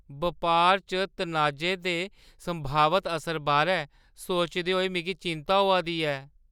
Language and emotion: Dogri, fearful